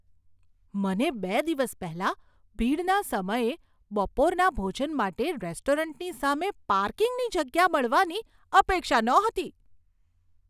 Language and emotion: Gujarati, surprised